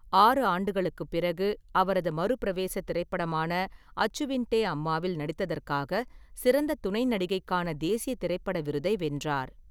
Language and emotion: Tamil, neutral